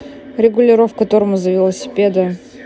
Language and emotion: Russian, neutral